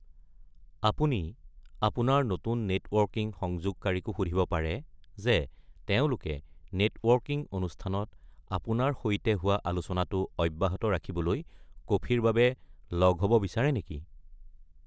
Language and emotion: Assamese, neutral